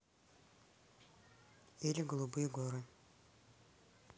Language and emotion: Russian, neutral